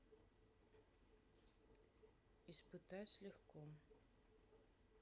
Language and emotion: Russian, neutral